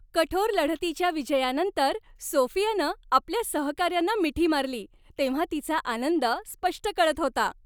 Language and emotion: Marathi, happy